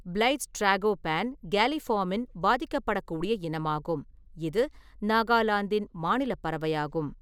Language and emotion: Tamil, neutral